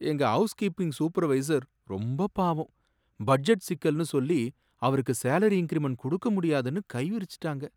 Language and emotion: Tamil, sad